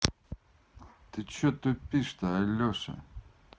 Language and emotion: Russian, angry